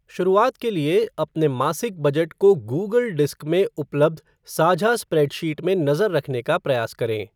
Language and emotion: Hindi, neutral